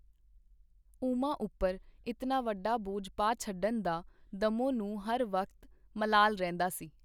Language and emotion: Punjabi, neutral